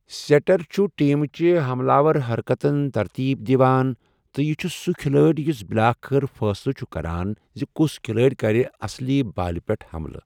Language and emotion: Kashmiri, neutral